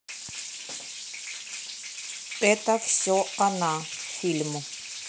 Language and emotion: Russian, neutral